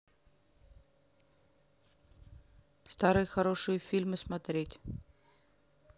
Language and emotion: Russian, neutral